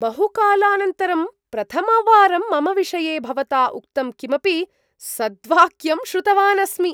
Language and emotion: Sanskrit, surprised